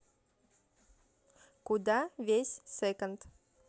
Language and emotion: Russian, neutral